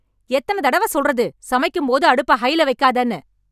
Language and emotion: Tamil, angry